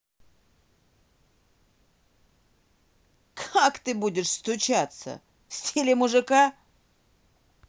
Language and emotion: Russian, angry